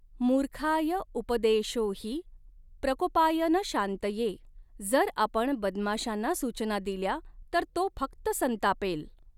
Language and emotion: Marathi, neutral